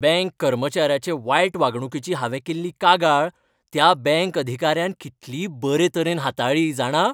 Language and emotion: Goan Konkani, happy